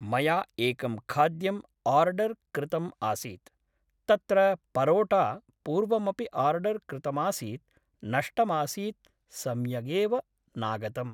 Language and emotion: Sanskrit, neutral